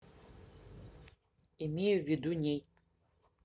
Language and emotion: Russian, neutral